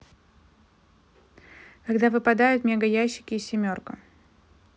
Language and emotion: Russian, neutral